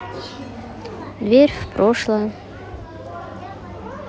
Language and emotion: Russian, sad